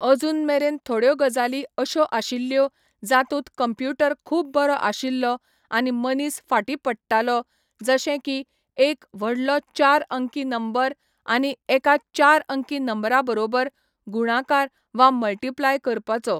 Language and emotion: Goan Konkani, neutral